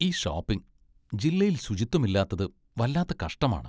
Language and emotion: Malayalam, disgusted